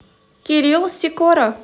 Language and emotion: Russian, positive